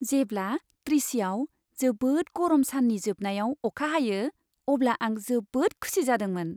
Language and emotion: Bodo, happy